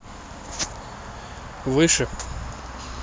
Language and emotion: Russian, neutral